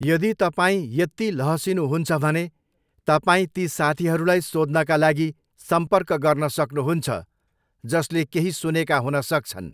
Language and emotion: Nepali, neutral